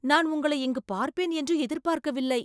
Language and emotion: Tamil, surprised